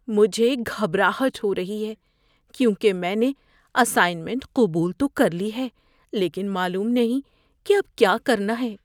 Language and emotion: Urdu, fearful